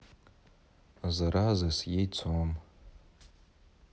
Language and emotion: Russian, neutral